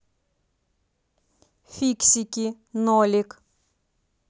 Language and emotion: Russian, neutral